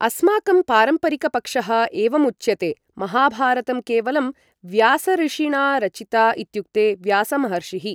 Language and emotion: Sanskrit, neutral